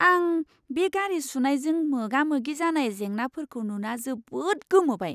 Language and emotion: Bodo, surprised